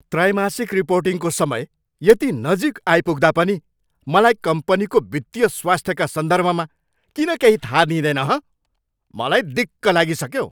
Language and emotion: Nepali, angry